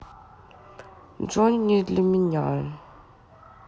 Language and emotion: Russian, sad